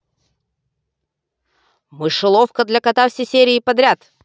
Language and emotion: Russian, angry